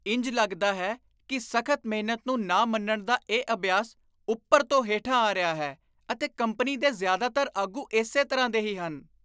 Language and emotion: Punjabi, disgusted